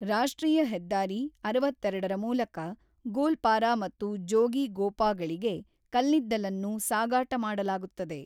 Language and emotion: Kannada, neutral